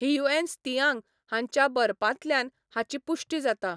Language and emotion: Goan Konkani, neutral